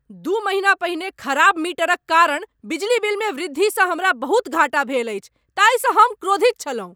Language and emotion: Maithili, angry